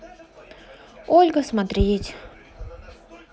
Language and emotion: Russian, sad